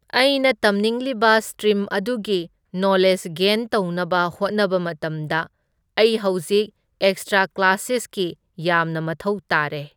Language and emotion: Manipuri, neutral